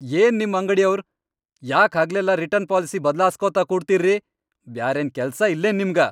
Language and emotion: Kannada, angry